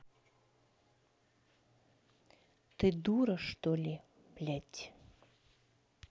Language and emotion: Russian, angry